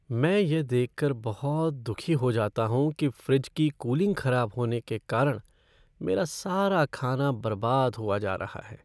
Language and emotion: Hindi, sad